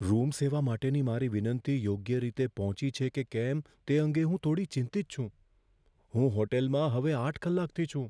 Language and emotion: Gujarati, fearful